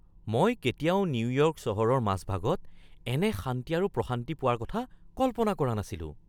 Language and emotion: Assamese, surprised